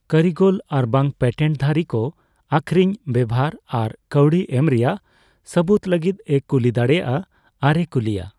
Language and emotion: Santali, neutral